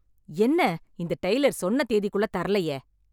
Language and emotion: Tamil, angry